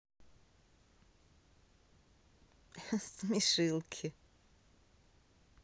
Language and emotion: Russian, positive